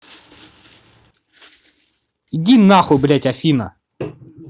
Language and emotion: Russian, angry